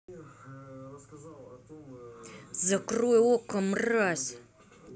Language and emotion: Russian, angry